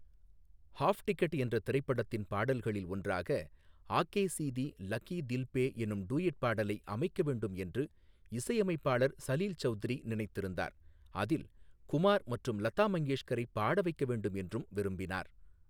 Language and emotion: Tamil, neutral